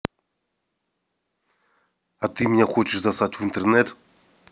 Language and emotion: Russian, angry